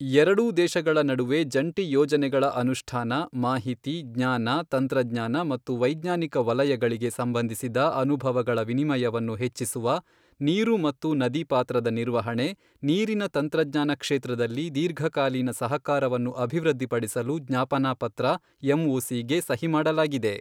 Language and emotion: Kannada, neutral